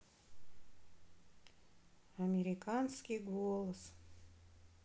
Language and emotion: Russian, sad